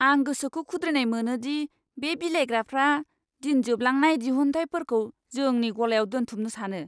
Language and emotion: Bodo, disgusted